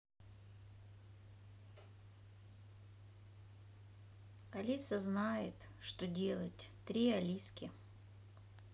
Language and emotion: Russian, sad